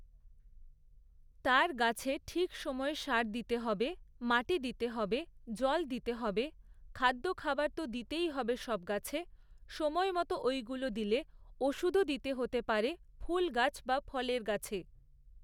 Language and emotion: Bengali, neutral